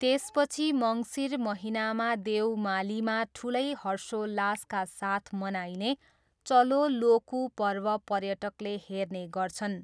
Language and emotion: Nepali, neutral